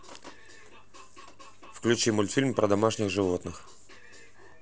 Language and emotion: Russian, neutral